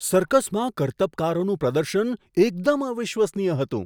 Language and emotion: Gujarati, surprised